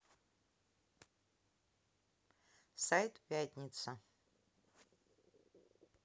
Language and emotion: Russian, neutral